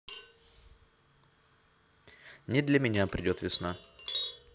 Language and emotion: Russian, neutral